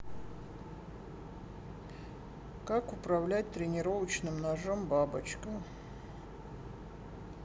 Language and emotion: Russian, sad